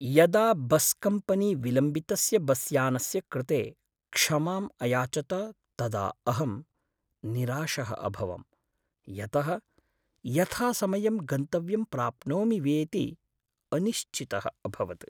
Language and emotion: Sanskrit, sad